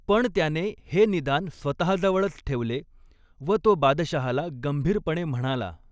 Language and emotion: Marathi, neutral